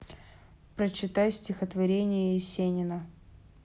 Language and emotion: Russian, neutral